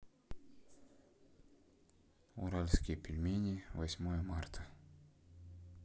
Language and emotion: Russian, sad